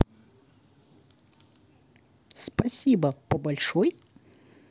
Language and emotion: Russian, neutral